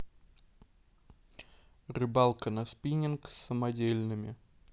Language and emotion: Russian, neutral